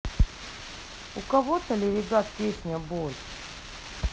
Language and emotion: Russian, neutral